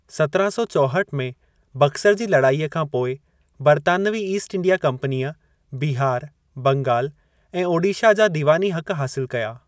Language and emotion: Sindhi, neutral